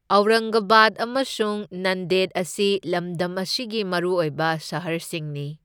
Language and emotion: Manipuri, neutral